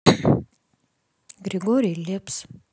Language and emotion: Russian, neutral